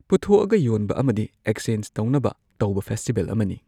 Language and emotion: Manipuri, neutral